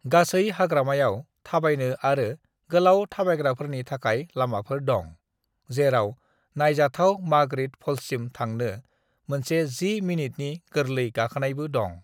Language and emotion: Bodo, neutral